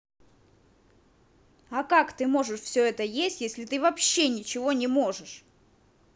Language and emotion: Russian, angry